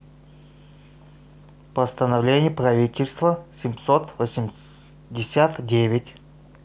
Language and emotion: Russian, neutral